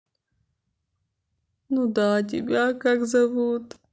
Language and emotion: Russian, sad